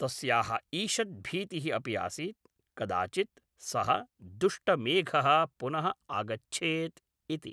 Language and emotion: Sanskrit, neutral